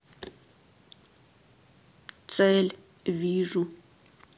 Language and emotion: Russian, neutral